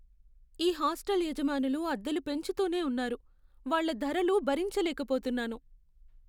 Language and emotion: Telugu, sad